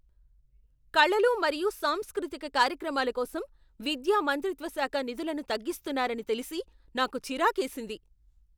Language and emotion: Telugu, angry